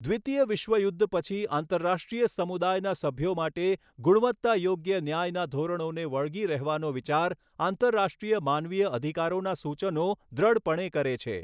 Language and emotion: Gujarati, neutral